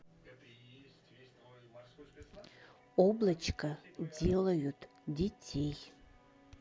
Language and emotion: Russian, neutral